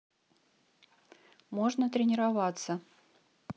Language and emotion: Russian, neutral